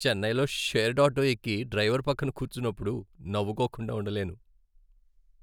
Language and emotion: Telugu, happy